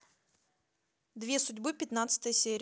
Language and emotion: Russian, neutral